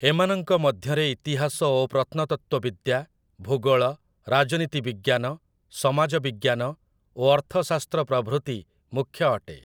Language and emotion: Odia, neutral